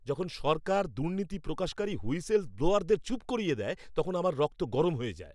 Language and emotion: Bengali, angry